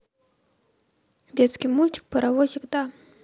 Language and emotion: Russian, neutral